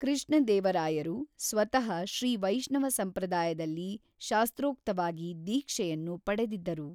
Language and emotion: Kannada, neutral